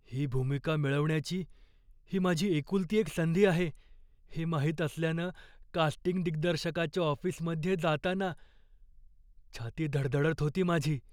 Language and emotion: Marathi, fearful